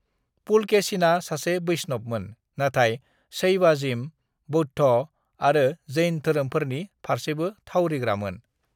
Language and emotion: Bodo, neutral